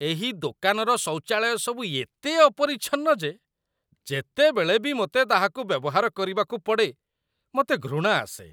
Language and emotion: Odia, disgusted